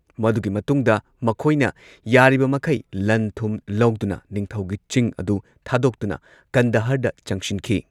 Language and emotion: Manipuri, neutral